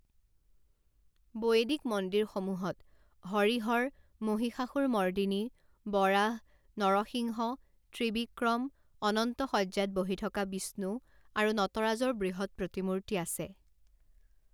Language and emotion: Assamese, neutral